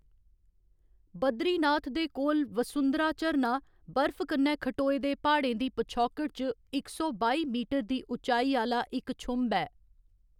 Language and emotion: Dogri, neutral